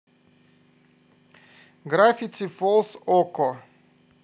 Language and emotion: Russian, neutral